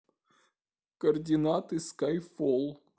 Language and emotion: Russian, sad